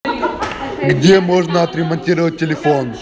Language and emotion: Russian, positive